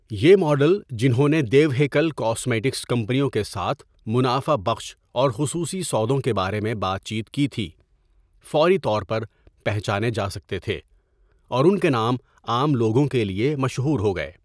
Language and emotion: Urdu, neutral